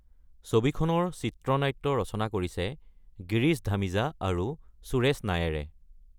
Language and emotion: Assamese, neutral